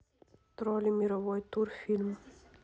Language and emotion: Russian, neutral